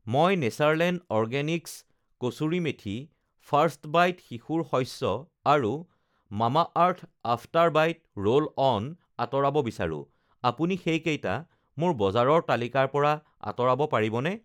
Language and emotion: Assamese, neutral